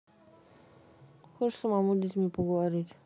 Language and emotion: Russian, neutral